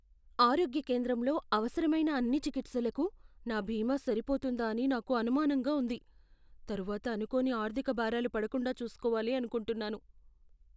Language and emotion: Telugu, fearful